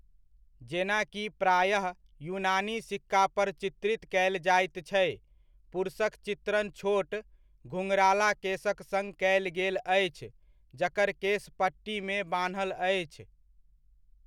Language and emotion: Maithili, neutral